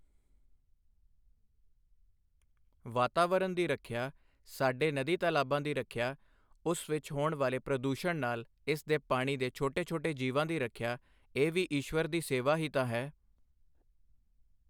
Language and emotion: Punjabi, neutral